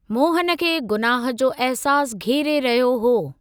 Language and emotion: Sindhi, neutral